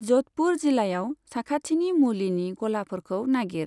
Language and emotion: Bodo, neutral